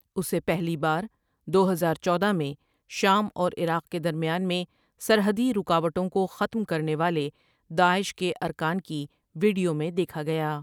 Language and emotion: Urdu, neutral